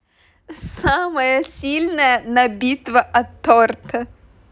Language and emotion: Russian, positive